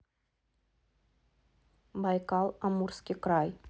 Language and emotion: Russian, neutral